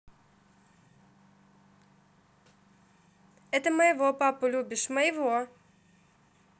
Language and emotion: Russian, positive